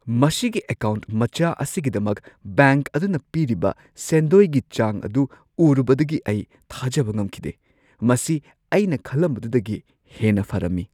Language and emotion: Manipuri, surprised